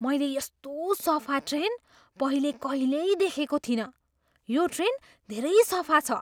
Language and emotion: Nepali, surprised